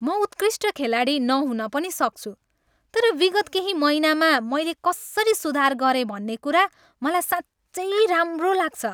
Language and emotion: Nepali, happy